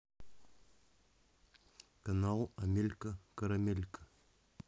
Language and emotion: Russian, neutral